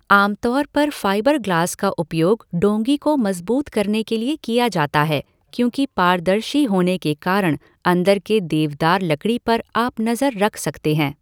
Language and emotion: Hindi, neutral